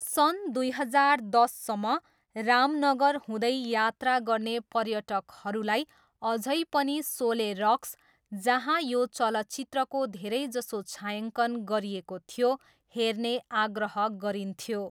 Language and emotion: Nepali, neutral